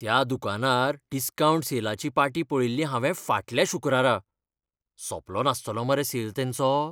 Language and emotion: Goan Konkani, fearful